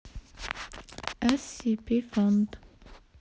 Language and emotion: Russian, neutral